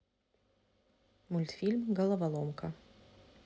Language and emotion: Russian, neutral